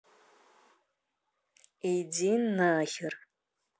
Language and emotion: Russian, angry